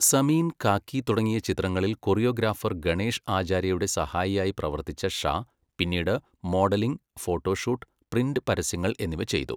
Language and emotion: Malayalam, neutral